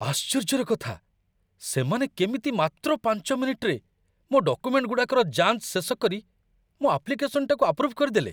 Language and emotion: Odia, surprised